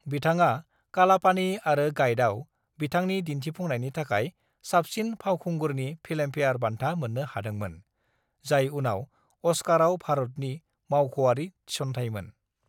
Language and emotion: Bodo, neutral